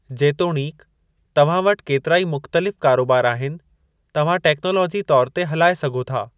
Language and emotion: Sindhi, neutral